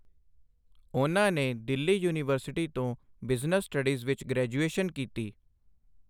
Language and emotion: Punjabi, neutral